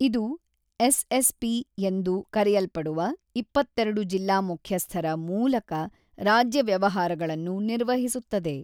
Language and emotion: Kannada, neutral